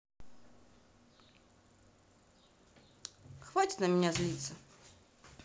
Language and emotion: Russian, neutral